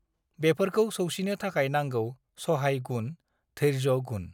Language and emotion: Bodo, neutral